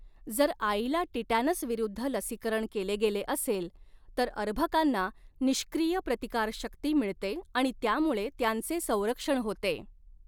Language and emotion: Marathi, neutral